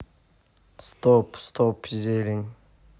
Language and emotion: Russian, neutral